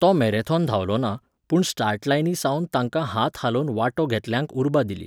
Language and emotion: Goan Konkani, neutral